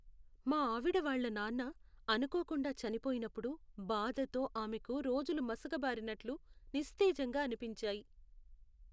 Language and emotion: Telugu, sad